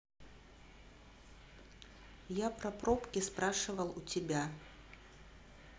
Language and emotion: Russian, neutral